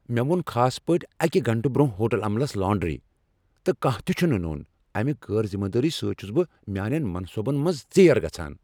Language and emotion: Kashmiri, angry